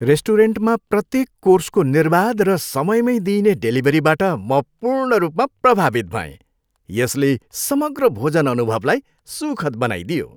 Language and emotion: Nepali, happy